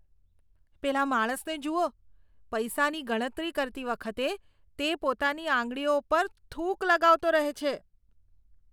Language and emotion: Gujarati, disgusted